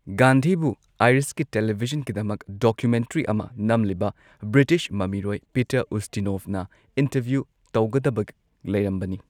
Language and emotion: Manipuri, neutral